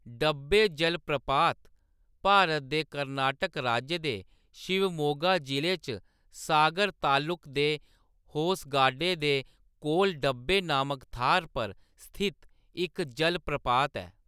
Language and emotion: Dogri, neutral